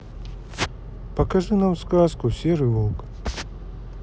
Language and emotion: Russian, sad